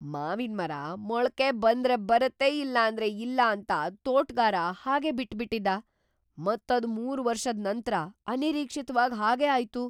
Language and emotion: Kannada, surprised